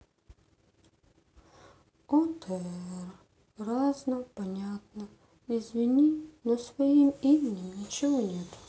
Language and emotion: Russian, sad